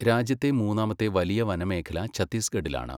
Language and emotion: Malayalam, neutral